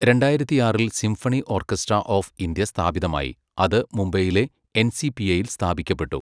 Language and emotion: Malayalam, neutral